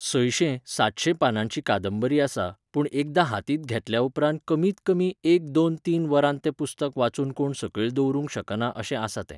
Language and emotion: Goan Konkani, neutral